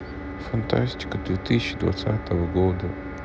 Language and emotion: Russian, sad